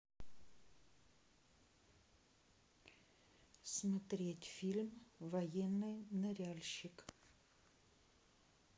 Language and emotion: Russian, neutral